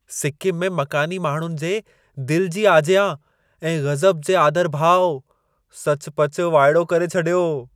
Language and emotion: Sindhi, surprised